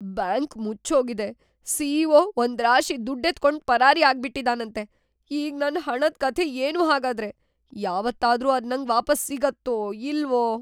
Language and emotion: Kannada, fearful